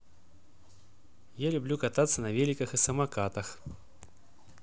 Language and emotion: Russian, positive